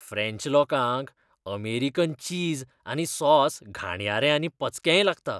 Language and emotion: Goan Konkani, disgusted